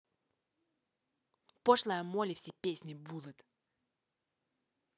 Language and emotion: Russian, angry